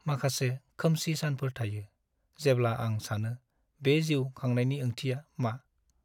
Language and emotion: Bodo, sad